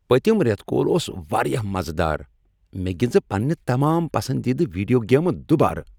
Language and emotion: Kashmiri, happy